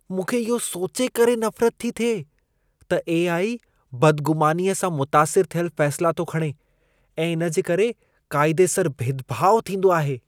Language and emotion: Sindhi, disgusted